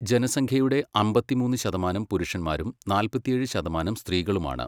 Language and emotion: Malayalam, neutral